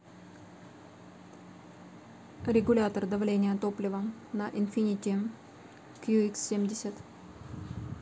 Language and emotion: Russian, neutral